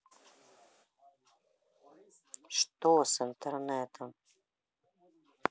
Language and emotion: Russian, neutral